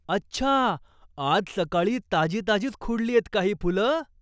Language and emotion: Marathi, surprised